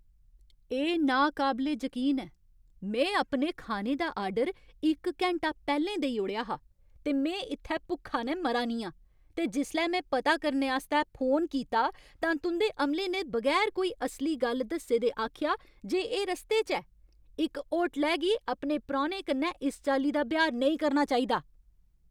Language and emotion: Dogri, angry